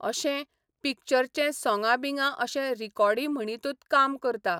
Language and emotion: Goan Konkani, neutral